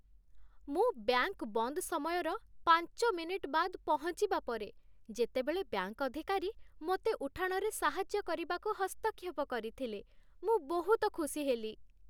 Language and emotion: Odia, happy